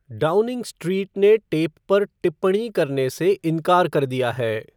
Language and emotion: Hindi, neutral